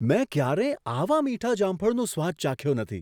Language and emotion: Gujarati, surprised